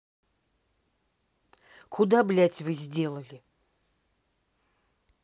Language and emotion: Russian, angry